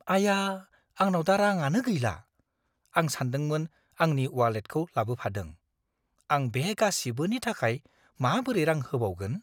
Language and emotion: Bodo, fearful